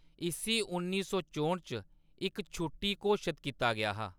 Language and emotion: Dogri, neutral